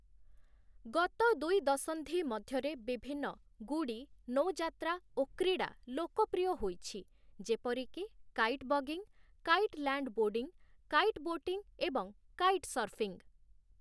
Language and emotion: Odia, neutral